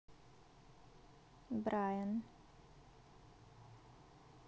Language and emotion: Russian, neutral